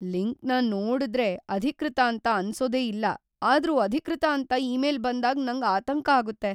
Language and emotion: Kannada, fearful